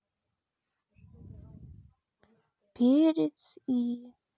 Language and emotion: Russian, sad